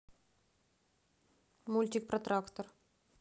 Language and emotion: Russian, neutral